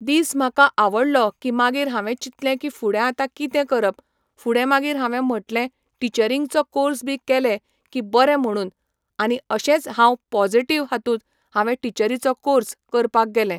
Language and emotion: Goan Konkani, neutral